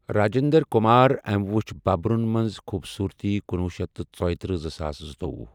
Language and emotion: Kashmiri, neutral